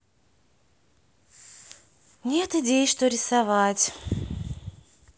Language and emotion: Russian, sad